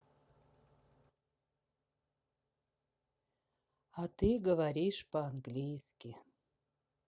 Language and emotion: Russian, sad